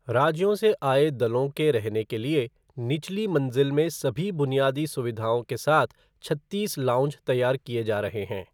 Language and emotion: Hindi, neutral